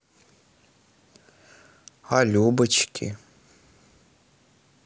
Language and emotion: Russian, neutral